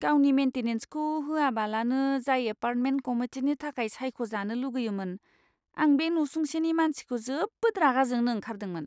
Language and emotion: Bodo, disgusted